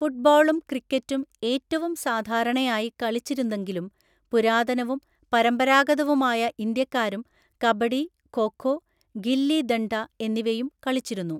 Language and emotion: Malayalam, neutral